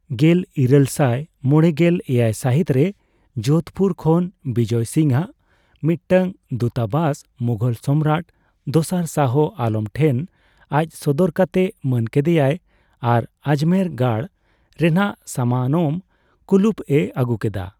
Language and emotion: Santali, neutral